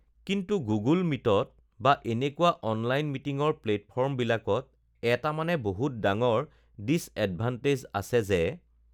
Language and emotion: Assamese, neutral